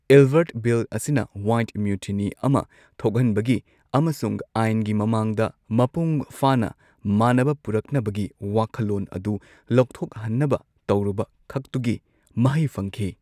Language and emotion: Manipuri, neutral